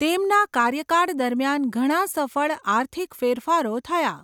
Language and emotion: Gujarati, neutral